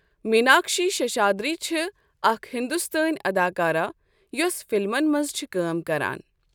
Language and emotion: Kashmiri, neutral